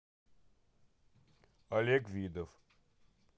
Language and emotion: Russian, neutral